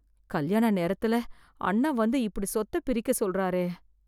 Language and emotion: Tamil, fearful